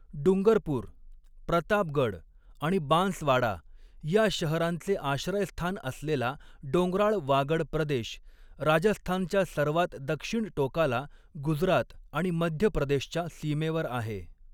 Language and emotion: Marathi, neutral